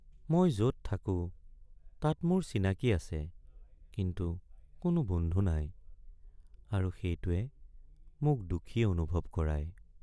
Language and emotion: Assamese, sad